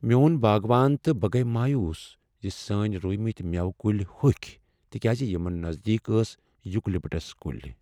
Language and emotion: Kashmiri, sad